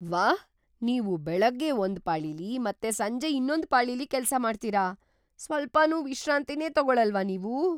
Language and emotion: Kannada, surprised